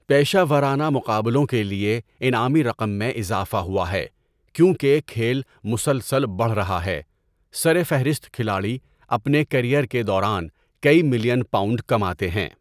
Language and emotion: Urdu, neutral